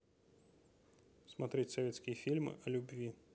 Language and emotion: Russian, neutral